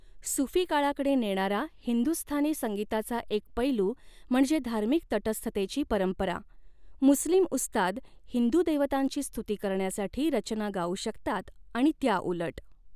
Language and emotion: Marathi, neutral